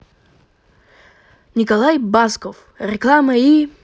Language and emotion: Russian, positive